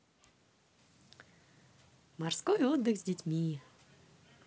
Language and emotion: Russian, positive